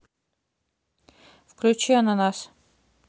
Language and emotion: Russian, neutral